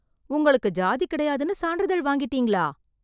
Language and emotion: Tamil, surprised